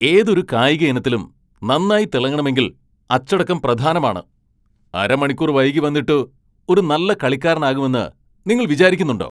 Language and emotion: Malayalam, angry